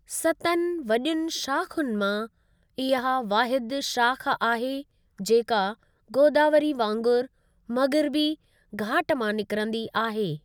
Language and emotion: Sindhi, neutral